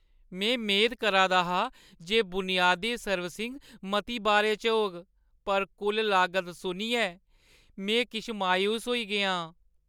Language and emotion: Dogri, sad